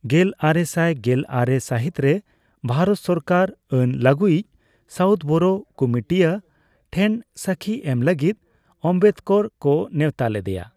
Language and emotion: Santali, neutral